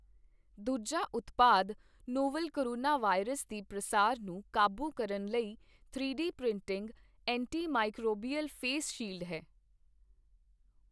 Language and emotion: Punjabi, neutral